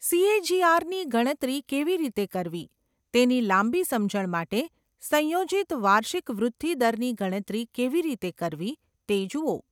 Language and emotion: Gujarati, neutral